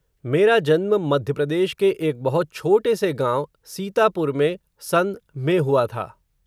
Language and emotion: Hindi, neutral